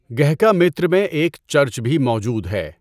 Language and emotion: Urdu, neutral